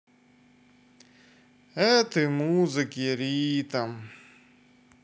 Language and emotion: Russian, sad